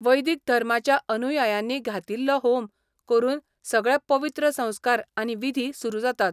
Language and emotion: Goan Konkani, neutral